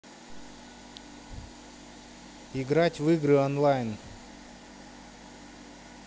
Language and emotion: Russian, neutral